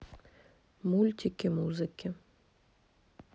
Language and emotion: Russian, neutral